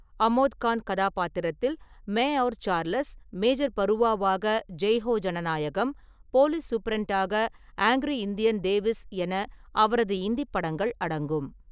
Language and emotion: Tamil, neutral